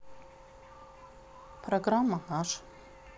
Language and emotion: Russian, neutral